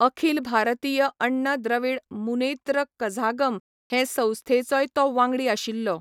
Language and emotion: Goan Konkani, neutral